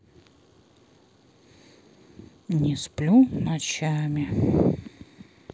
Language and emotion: Russian, neutral